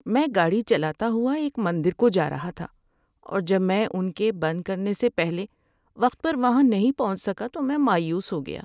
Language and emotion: Urdu, sad